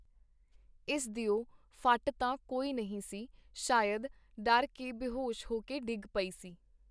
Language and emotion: Punjabi, neutral